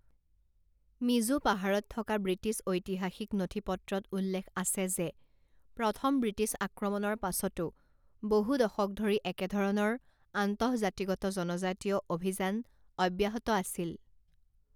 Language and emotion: Assamese, neutral